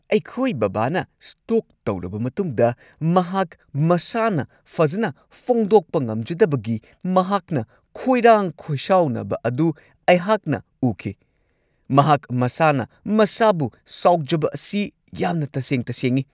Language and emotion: Manipuri, angry